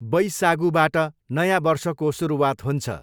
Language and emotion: Nepali, neutral